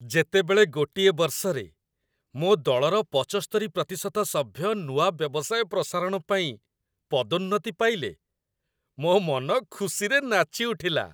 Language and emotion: Odia, happy